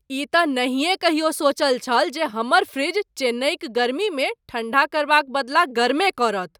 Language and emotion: Maithili, surprised